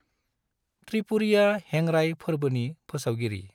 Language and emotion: Bodo, neutral